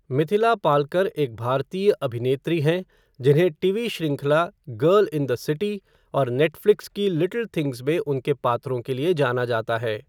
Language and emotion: Hindi, neutral